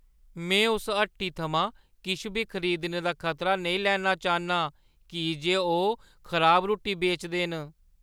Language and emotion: Dogri, fearful